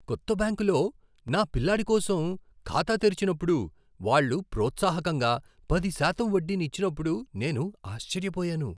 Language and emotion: Telugu, surprised